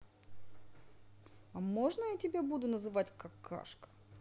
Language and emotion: Russian, neutral